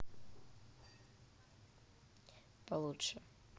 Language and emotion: Russian, neutral